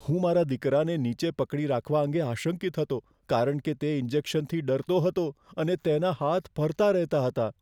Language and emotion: Gujarati, fearful